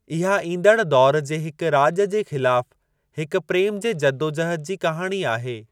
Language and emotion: Sindhi, neutral